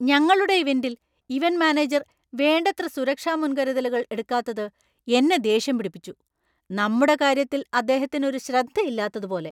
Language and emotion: Malayalam, angry